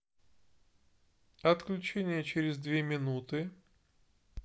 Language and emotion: Russian, neutral